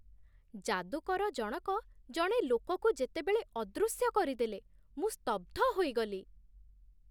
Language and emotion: Odia, surprised